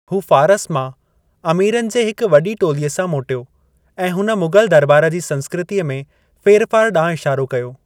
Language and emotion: Sindhi, neutral